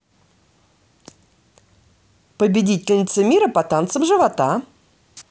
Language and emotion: Russian, positive